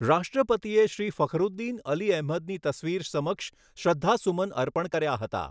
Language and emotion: Gujarati, neutral